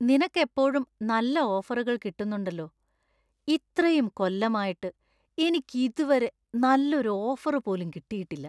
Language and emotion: Malayalam, disgusted